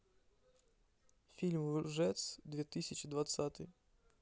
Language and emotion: Russian, neutral